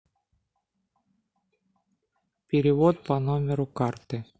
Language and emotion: Russian, neutral